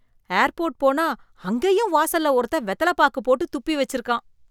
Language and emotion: Tamil, disgusted